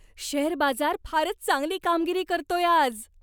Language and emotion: Marathi, happy